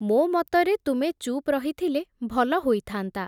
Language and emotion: Odia, neutral